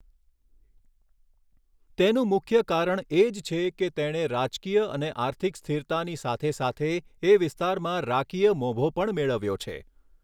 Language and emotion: Gujarati, neutral